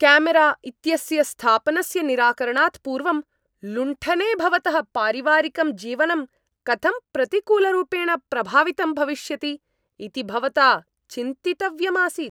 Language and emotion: Sanskrit, angry